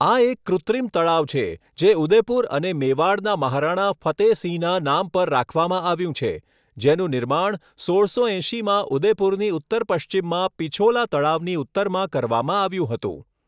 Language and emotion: Gujarati, neutral